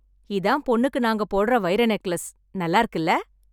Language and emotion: Tamil, happy